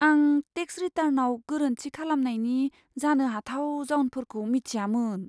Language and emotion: Bodo, fearful